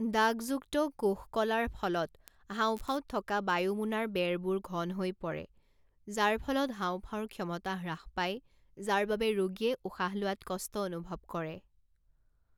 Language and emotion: Assamese, neutral